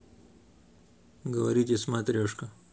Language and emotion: Russian, neutral